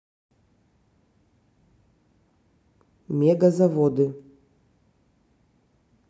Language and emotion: Russian, neutral